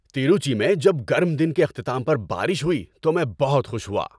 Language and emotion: Urdu, happy